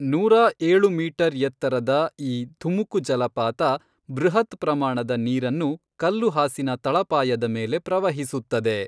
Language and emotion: Kannada, neutral